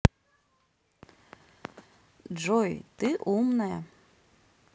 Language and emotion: Russian, positive